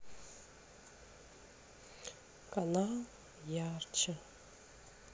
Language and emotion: Russian, sad